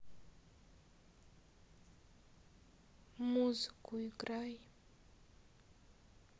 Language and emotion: Russian, sad